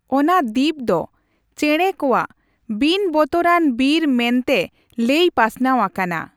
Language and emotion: Santali, neutral